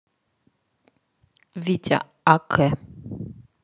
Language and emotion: Russian, neutral